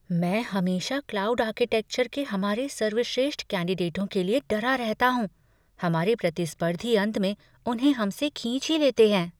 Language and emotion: Hindi, fearful